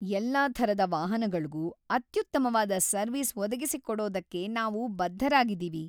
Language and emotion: Kannada, happy